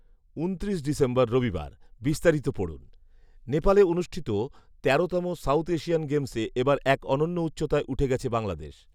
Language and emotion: Bengali, neutral